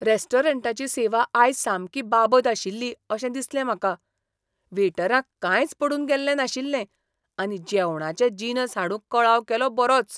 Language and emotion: Goan Konkani, disgusted